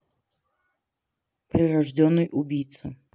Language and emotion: Russian, neutral